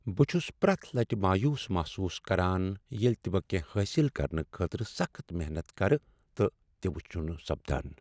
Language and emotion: Kashmiri, sad